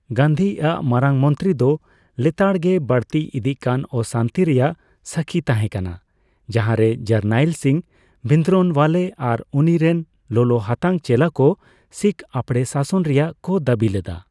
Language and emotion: Santali, neutral